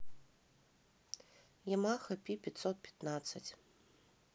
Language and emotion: Russian, neutral